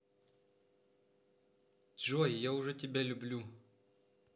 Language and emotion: Russian, positive